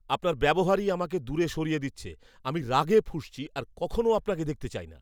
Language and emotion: Bengali, angry